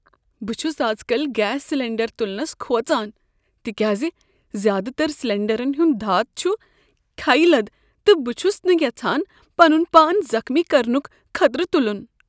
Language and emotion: Kashmiri, fearful